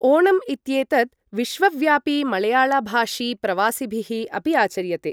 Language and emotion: Sanskrit, neutral